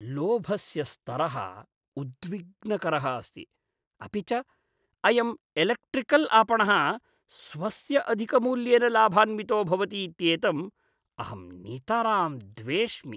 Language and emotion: Sanskrit, disgusted